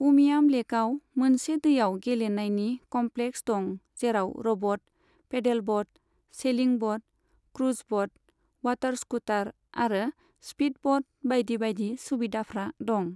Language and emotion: Bodo, neutral